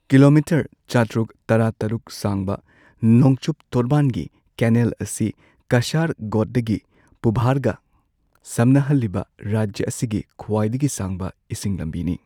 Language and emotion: Manipuri, neutral